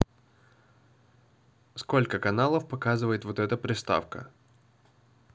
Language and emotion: Russian, positive